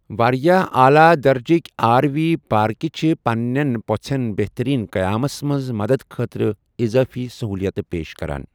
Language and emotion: Kashmiri, neutral